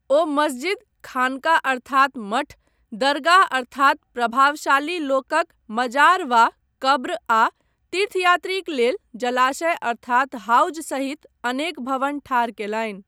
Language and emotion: Maithili, neutral